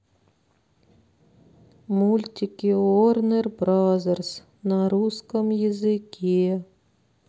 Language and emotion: Russian, sad